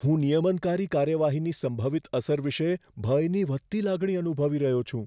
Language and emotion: Gujarati, fearful